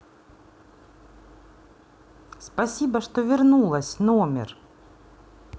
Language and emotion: Russian, positive